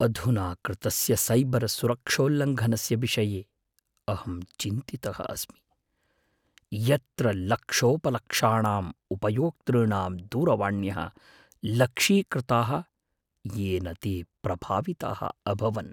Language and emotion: Sanskrit, fearful